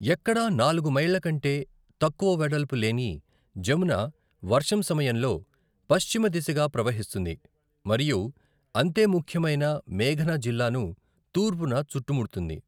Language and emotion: Telugu, neutral